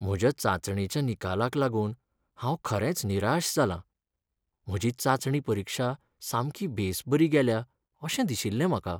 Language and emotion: Goan Konkani, sad